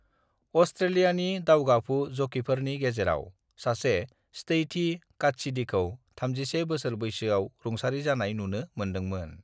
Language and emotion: Bodo, neutral